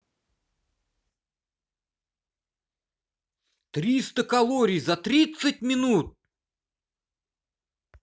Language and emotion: Russian, angry